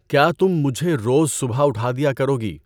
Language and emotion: Urdu, neutral